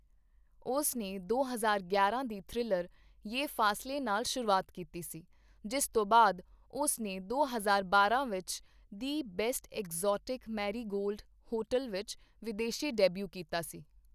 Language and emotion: Punjabi, neutral